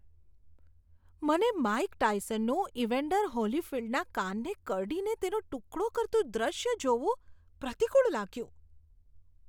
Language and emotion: Gujarati, disgusted